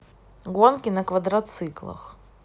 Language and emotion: Russian, neutral